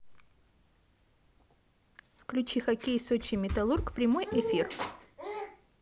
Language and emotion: Russian, positive